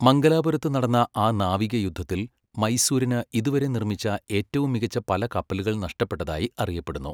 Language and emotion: Malayalam, neutral